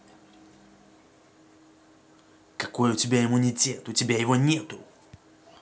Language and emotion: Russian, angry